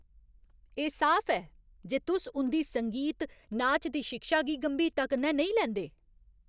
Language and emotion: Dogri, angry